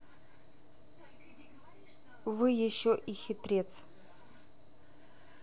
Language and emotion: Russian, neutral